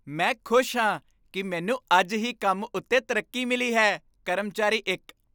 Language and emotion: Punjabi, happy